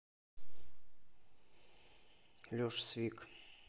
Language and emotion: Russian, neutral